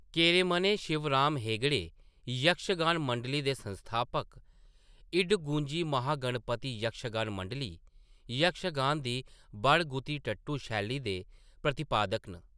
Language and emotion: Dogri, neutral